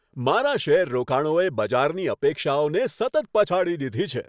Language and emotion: Gujarati, happy